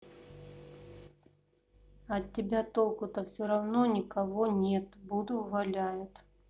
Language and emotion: Russian, neutral